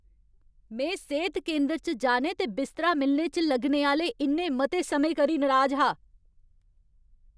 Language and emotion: Dogri, angry